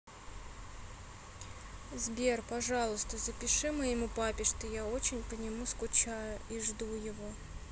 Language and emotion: Russian, sad